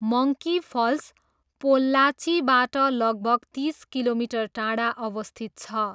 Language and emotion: Nepali, neutral